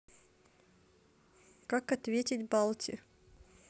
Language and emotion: Russian, neutral